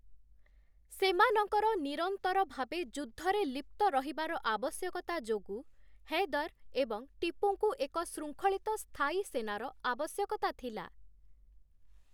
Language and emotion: Odia, neutral